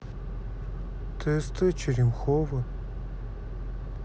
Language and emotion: Russian, sad